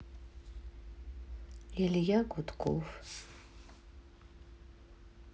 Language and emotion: Russian, sad